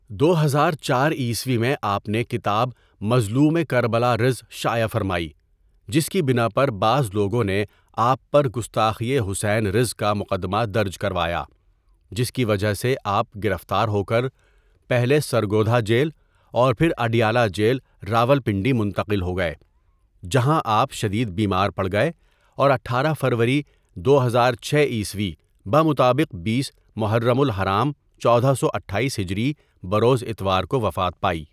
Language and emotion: Urdu, neutral